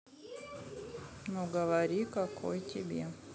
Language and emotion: Russian, neutral